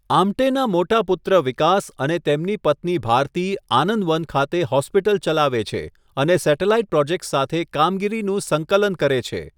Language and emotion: Gujarati, neutral